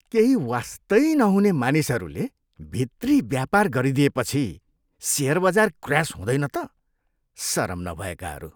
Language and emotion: Nepali, disgusted